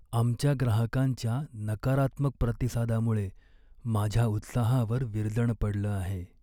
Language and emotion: Marathi, sad